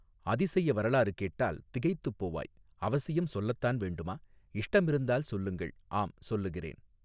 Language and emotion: Tamil, neutral